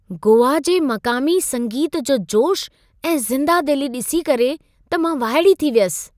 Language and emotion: Sindhi, surprised